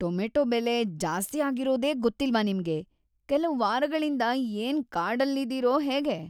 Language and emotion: Kannada, disgusted